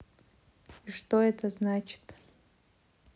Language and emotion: Russian, neutral